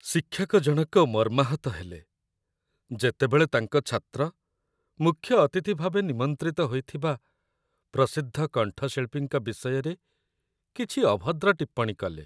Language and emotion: Odia, sad